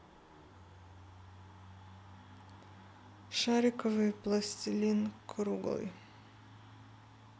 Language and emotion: Russian, neutral